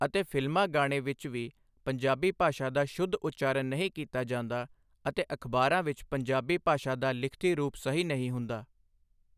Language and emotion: Punjabi, neutral